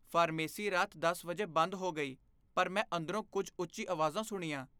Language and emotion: Punjabi, fearful